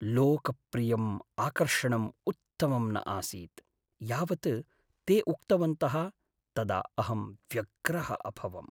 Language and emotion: Sanskrit, sad